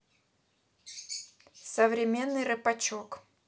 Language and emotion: Russian, neutral